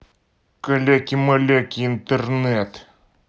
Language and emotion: Russian, angry